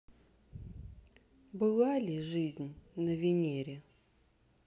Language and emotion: Russian, sad